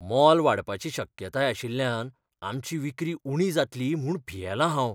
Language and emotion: Goan Konkani, fearful